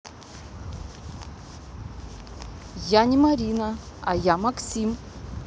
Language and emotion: Russian, neutral